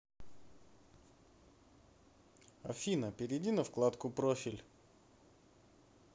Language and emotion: Russian, neutral